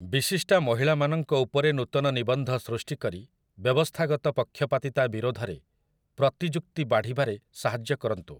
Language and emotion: Odia, neutral